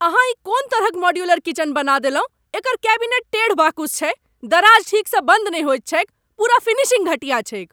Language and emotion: Maithili, angry